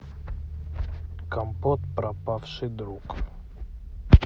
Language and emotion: Russian, neutral